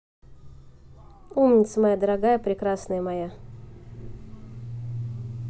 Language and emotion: Russian, neutral